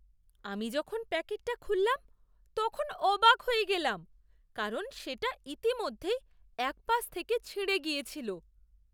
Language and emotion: Bengali, surprised